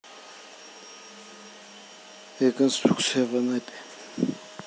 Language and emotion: Russian, neutral